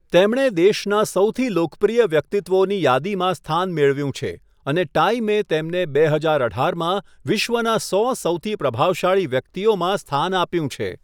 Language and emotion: Gujarati, neutral